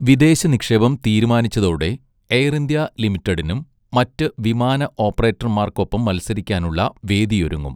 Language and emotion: Malayalam, neutral